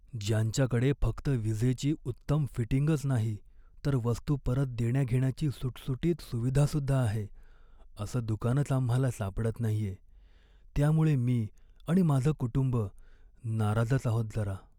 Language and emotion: Marathi, sad